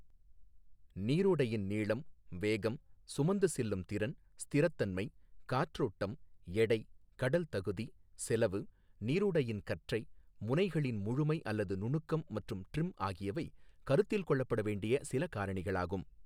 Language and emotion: Tamil, neutral